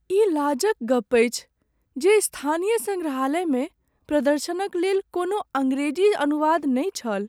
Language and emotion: Maithili, sad